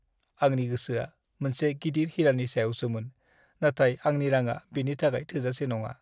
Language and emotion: Bodo, sad